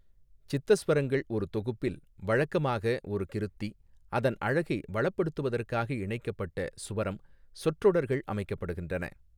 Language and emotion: Tamil, neutral